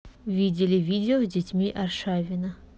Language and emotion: Russian, neutral